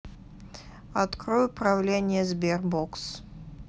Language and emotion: Russian, neutral